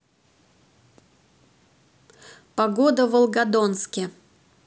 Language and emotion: Russian, neutral